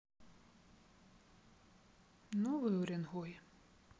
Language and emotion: Russian, sad